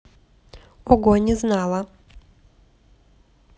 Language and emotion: Russian, neutral